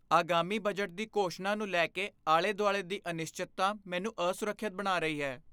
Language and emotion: Punjabi, fearful